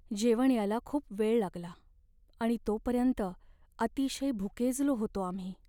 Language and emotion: Marathi, sad